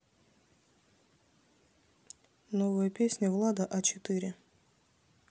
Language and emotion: Russian, neutral